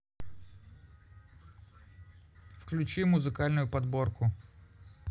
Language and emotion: Russian, neutral